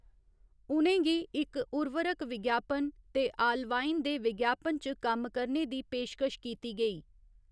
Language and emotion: Dogri, neutral